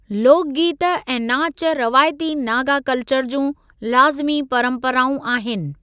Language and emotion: Sindhi, neutral